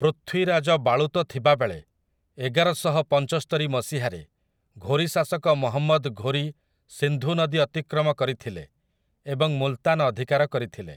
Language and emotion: Odia, neutral